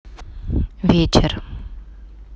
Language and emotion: Russian, neutral